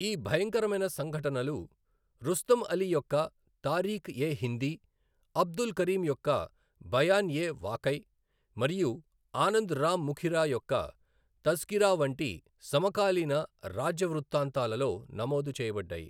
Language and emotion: Telugu, neutral